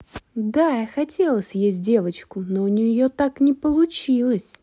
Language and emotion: Russian, neutral